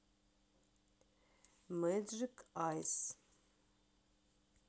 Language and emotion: Russian, neutral